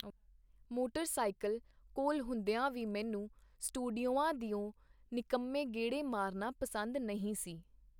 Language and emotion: Punjabi, neutral